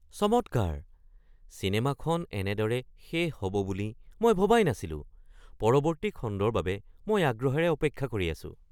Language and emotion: Assamese, surprised